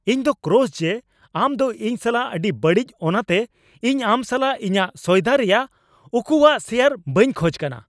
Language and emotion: Santali, angry